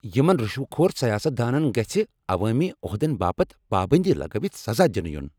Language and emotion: Kashmiri, angry